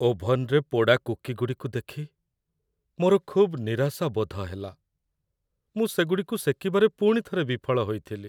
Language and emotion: Odia, sad